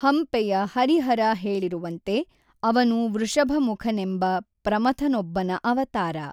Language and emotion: Kannada, neutral